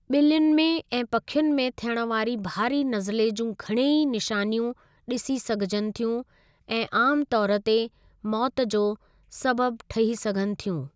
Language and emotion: Sindhi, neutral